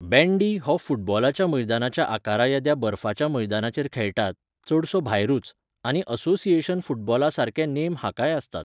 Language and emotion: Goan Konkani, neutral